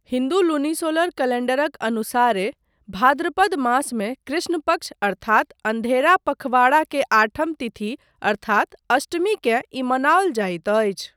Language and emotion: Maithili, neutral